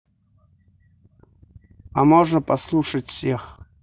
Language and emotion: Russian, neutral